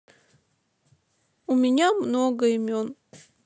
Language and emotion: Russian, sad